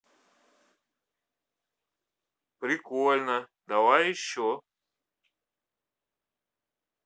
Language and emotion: Russian, positive